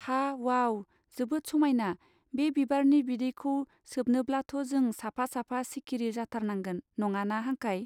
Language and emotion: Bodo, neutral